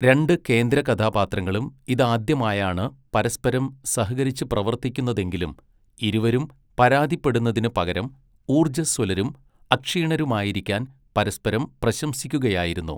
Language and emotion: Malayalam, neutral